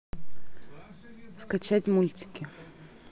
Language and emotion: Russian, neutral